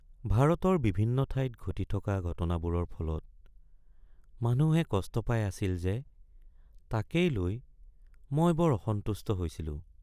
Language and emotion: Assamese, sad